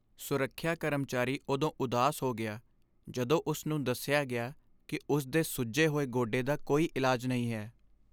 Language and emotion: Punjabi, sad